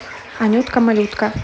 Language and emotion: Russian, positive